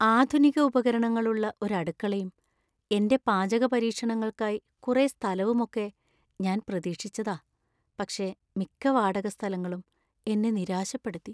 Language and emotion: Malayalam, sad